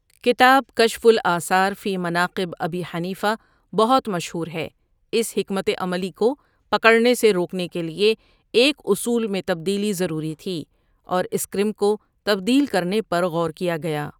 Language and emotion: Urdu, neutral